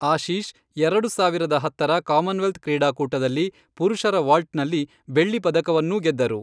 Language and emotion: Kannada, neutral